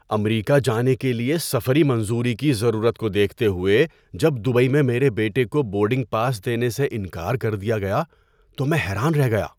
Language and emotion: Urdu, surprised